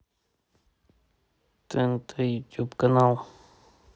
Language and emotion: Russian, neutral